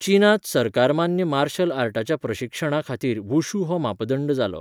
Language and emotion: Goan Konkani, neutral